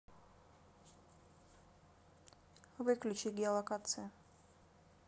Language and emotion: Russian, neutral